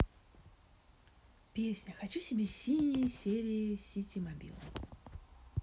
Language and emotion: Russian, positive